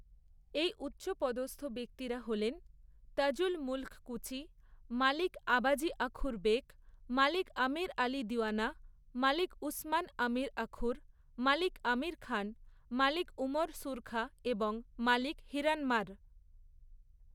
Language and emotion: Bengali, neutral